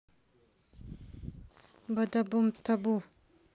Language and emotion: Russian, neutral